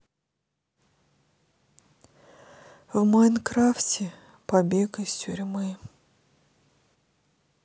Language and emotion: Russian, sad